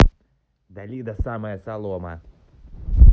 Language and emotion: Russian, neutral